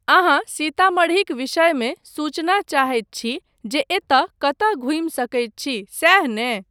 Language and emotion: Maithili, neutral